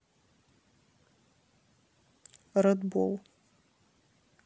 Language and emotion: Russian, neutral